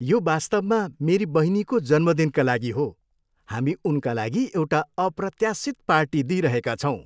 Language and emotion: Nepali, happy